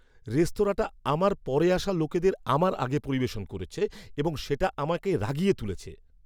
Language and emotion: Bengali, angry